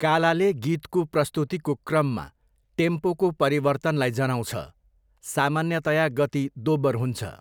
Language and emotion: Nepali, neutral